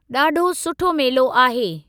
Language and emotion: Sindhi, neutral